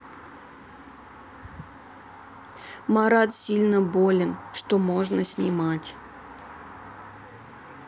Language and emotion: Russian, sad